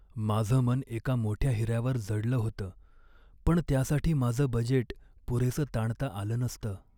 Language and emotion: Marathi, sad